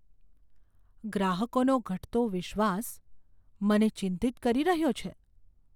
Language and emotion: Gujarati, fearful